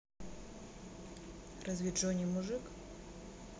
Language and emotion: Russian, neutral